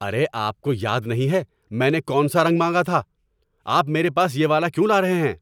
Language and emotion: Urdu, angry